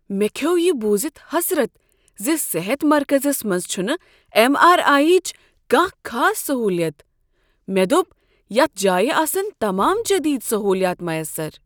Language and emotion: Kashmiri, surprised